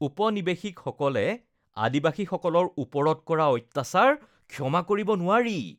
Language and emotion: Assamese, disgusted